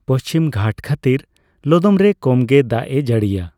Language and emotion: Santali, neutral